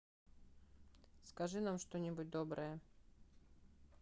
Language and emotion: Russian, neutral